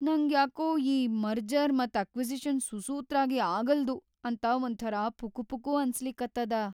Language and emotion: Kannada, fearful